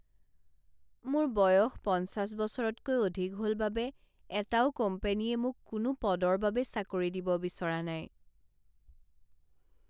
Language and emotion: Assamese, sad